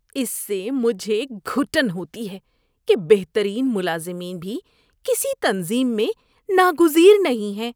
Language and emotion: Urdu, disgusted